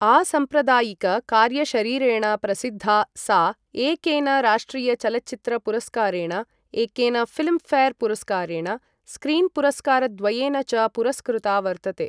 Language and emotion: Sanskrit, neutral